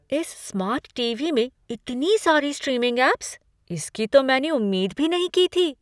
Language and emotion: Hindi, surprised